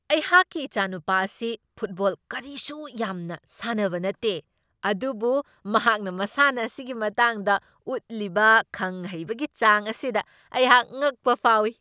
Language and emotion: Manipuri, surprised